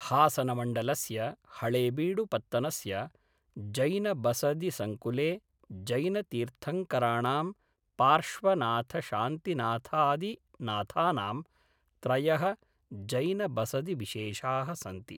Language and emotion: Sanskrit, neutral